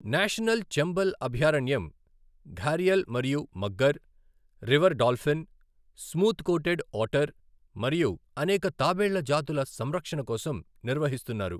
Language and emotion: Telugu, neutral